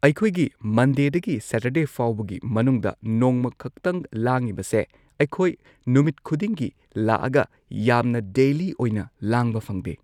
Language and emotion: Manipuri, neutral